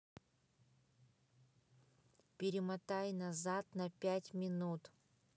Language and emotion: Russian, neutral